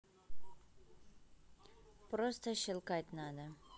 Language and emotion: Russian, neutral